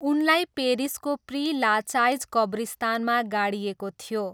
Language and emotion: Nepali, neutral